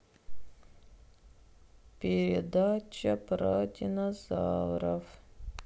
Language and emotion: Russian, sad